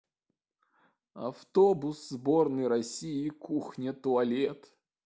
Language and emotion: Russian, sad